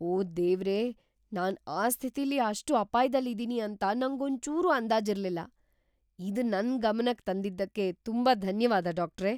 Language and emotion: Kannada, surprised